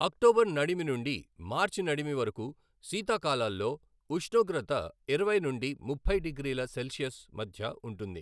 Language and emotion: Telugu, neutral